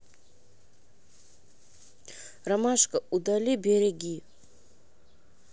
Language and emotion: Russian, neutral